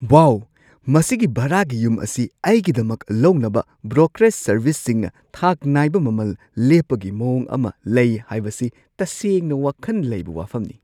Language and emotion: Manipuri, surprised